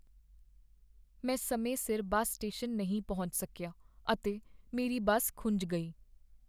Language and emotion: Punjabi, sad